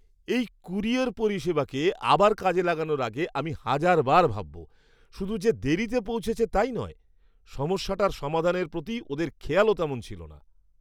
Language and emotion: Bengali, disgusted